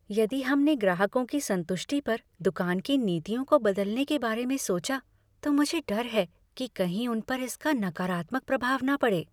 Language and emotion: Hindi, fearful